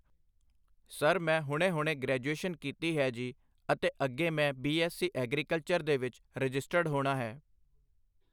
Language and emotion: Punjabi, neutral